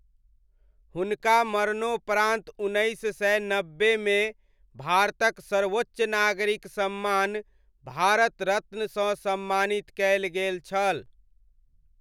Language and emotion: Maithili, neutral